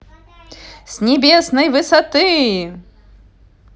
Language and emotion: Russian, positive